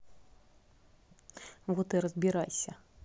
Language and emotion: Russian, neutral